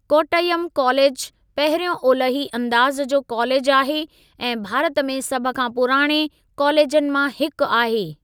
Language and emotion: Sindhi, neutral